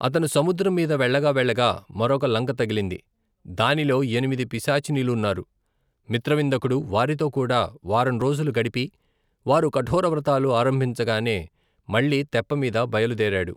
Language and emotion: Telugu, neutral